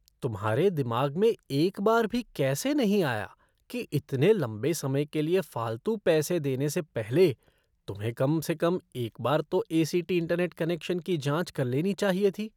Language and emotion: Hindi, disgusted